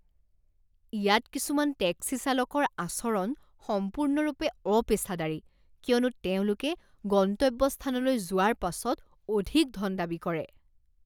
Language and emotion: Assamese, disgusted